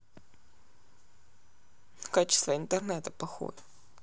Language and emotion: Russian, sad